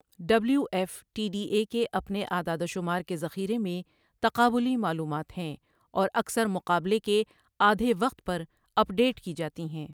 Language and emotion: Urdu, neutral